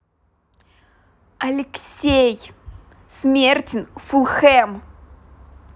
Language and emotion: Russian, angry